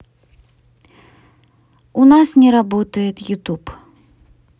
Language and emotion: Russian, neutral